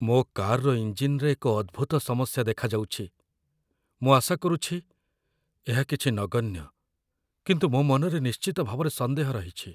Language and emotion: Odia, fearful